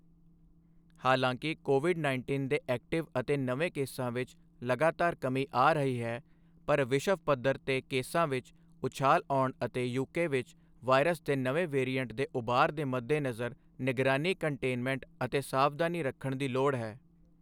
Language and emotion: Punjabi, neutral